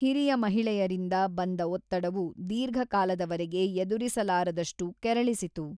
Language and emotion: Kannada, neutral